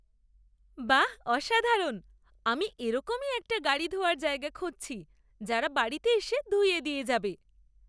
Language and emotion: Bengali, happy